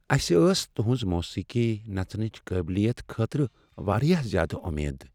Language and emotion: Kashmiri, sad